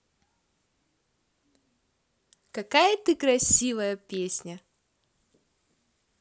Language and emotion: Russian, positive